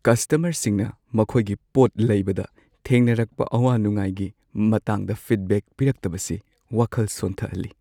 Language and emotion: Manipuri, sad